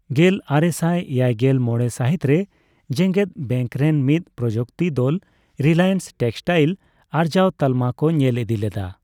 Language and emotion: Santali, neutral